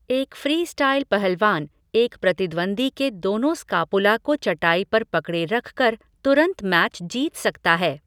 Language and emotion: Hindi, neutral